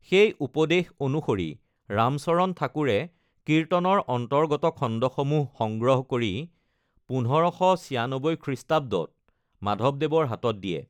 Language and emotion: Assamese, neutral